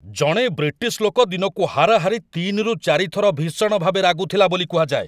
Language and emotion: Odia, angry